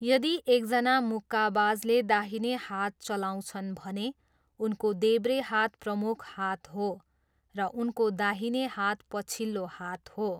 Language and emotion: Nepali, neutral